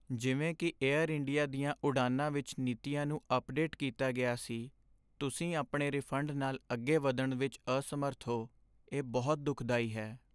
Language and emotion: Punjabi, sad